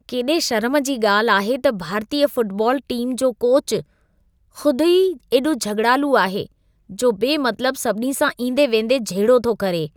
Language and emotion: Sindhi, disgusted